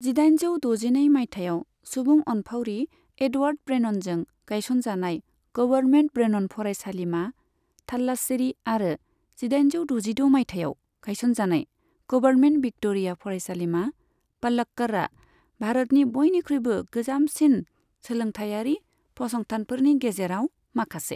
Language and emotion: Bodo, neutral